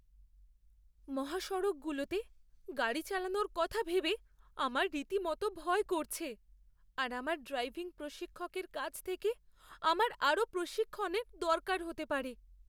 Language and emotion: Bengali, fearful